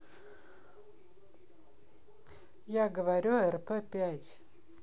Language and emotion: Russian, neutral